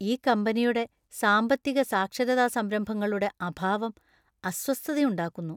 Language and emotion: Malayalam, disgusted